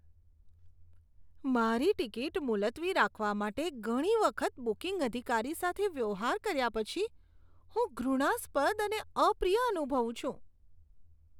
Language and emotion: Gujarati, disgusted